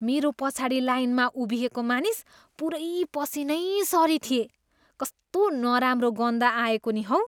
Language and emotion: Nepali, disgusted